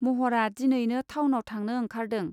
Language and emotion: Bodo, neutral